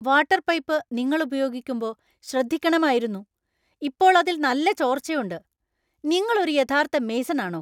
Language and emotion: Malayalam, angry